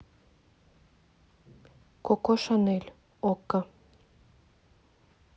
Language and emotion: Russian, neutral